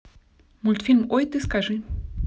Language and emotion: Russian, neutral